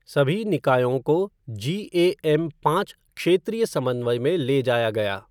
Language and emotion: Hindi, neutral